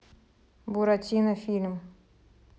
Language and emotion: Russian, neutral